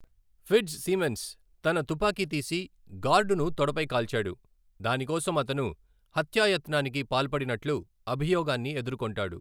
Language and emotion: Telugu, neutral